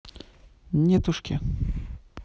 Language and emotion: Russian, neutral